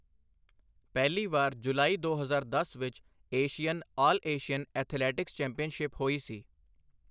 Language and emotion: Punjabi, neutral